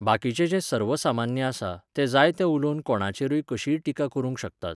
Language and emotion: Goan Konkani, neutral